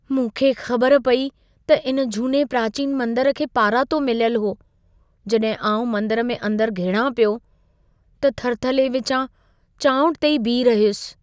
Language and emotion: Sindhi, fearful